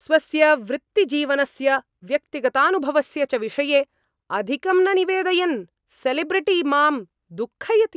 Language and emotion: Sanskrit, angry